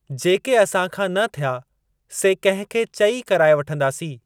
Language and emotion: Sindhi, neutral